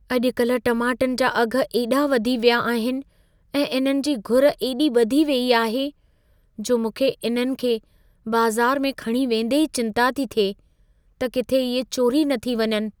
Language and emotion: Sindhi, fearful